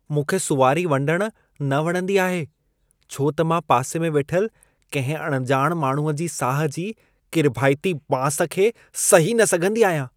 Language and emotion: Sindhi, disgusted